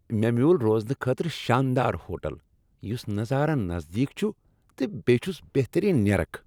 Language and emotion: Kashmiri, happy